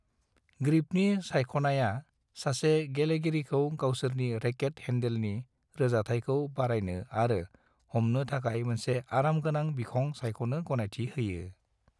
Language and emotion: Bodo, neutral